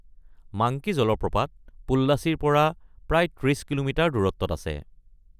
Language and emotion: Assamese, neutral